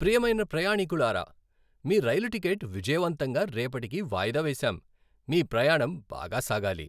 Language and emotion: Telugu, happy